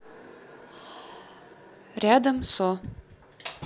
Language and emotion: Russian, neutral